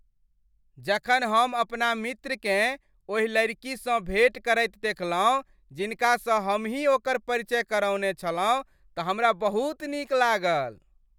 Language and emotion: Maithili, happy